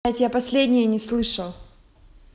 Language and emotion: Russian, angry